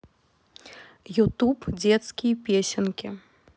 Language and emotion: Russian, neutral